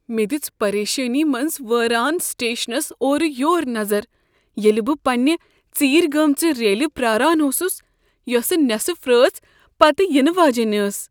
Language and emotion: Kashmiri, fearful